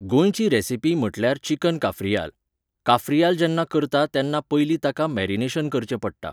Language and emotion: Goan Konkani, neutral